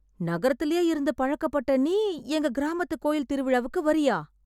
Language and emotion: Tamil, surprised